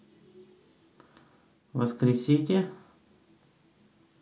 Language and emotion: Russian, neutral